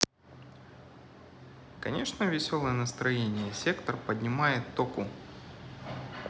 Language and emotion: Russian, neutral